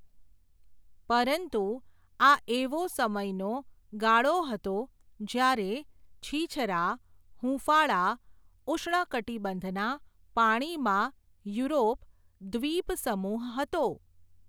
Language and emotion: Gujarati, neutral